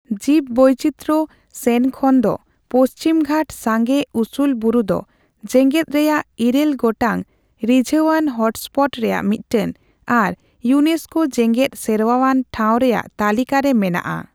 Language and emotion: Santali, neutral